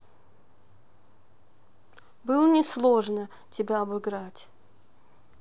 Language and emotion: Russian, neutral